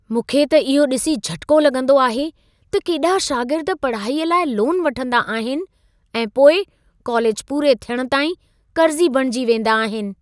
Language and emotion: Sindhi, surprised